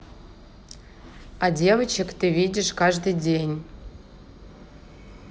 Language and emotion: Russian, neutral